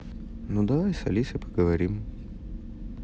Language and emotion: Russian, neutral